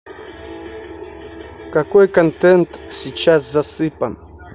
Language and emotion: Russian, neutral